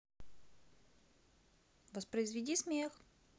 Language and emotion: Russian, neutral